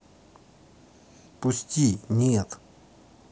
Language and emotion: Russian, neutral